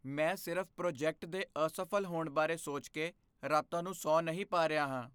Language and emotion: Punjabi, fearful